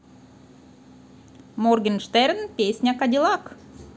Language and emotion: Russian, positive